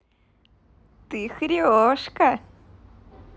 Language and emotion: Russian, positive